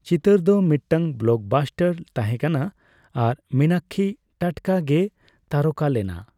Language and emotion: Santali, neutral